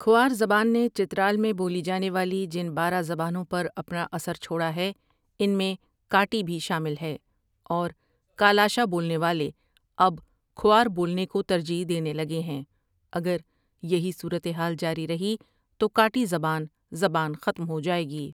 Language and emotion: Urdu, neutral